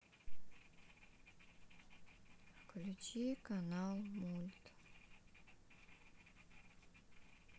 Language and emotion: Russian, sad